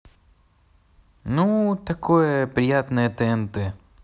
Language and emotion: Russian, neutral